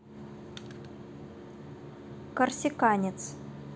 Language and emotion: Russian, neutral